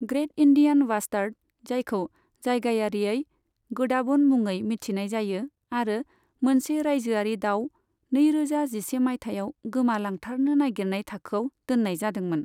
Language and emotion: Bodo, neutral